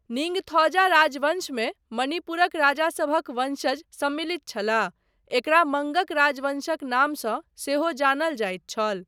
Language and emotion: Maithili, neutral